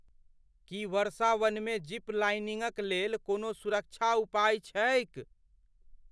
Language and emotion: Maithili, fearful